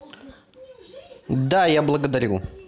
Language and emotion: Russian, neutral